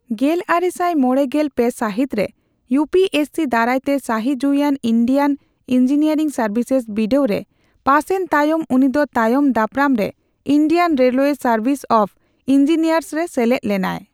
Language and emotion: Santali, neutral